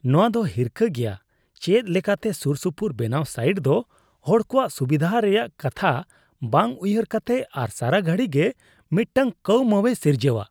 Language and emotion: Santali, disgusted